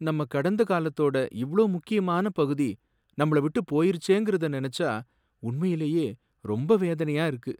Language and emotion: Tamil, sad